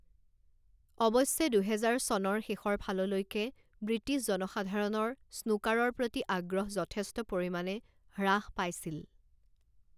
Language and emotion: Assamese, neutral